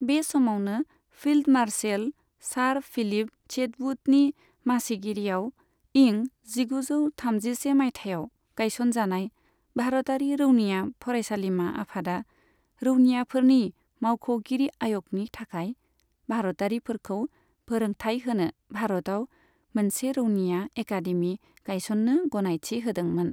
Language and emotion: Bodo, neutral